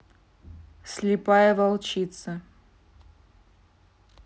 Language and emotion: Russian, neutral